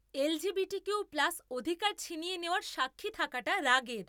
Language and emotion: Bengali, angry